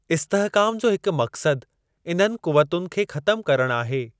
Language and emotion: Sindhi, neutral